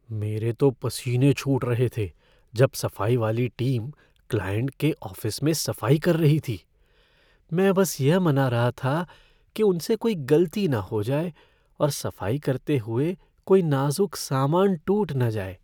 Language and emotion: Hindi, fearful